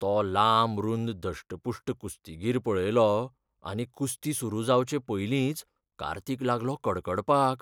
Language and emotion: Goan Konkani, fearful